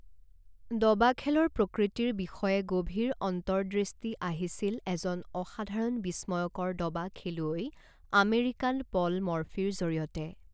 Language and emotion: Assamese, neutral